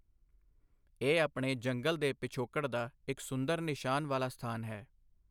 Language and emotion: Punjabi, neutral